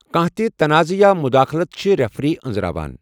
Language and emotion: Kashmiri, neutral